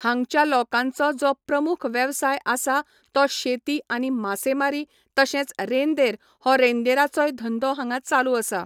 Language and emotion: Goan Konkani, neutral